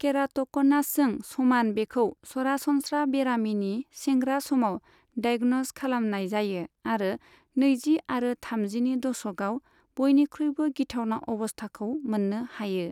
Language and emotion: Bodo, neutral